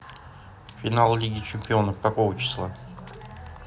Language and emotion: Russian, neutral